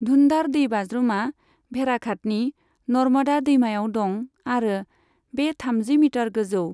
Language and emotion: Bodo, neutral